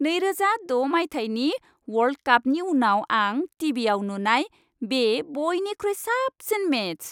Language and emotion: Bodo, happy